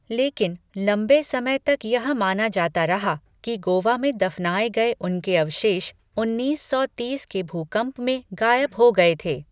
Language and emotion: Hindi, neutral